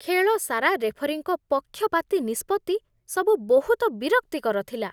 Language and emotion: Odia, disgusted